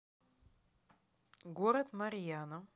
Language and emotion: Russian, neutral